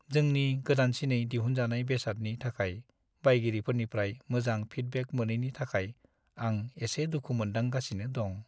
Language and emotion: Bodo, sad